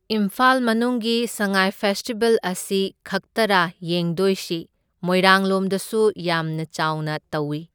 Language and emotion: Manipuri, neutral